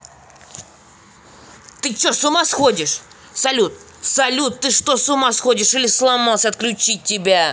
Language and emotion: Russian, angry